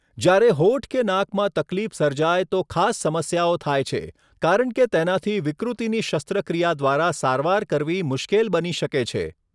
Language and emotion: Gujarati, neutral